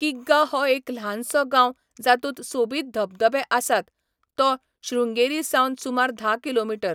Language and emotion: Goan Konkani, neutral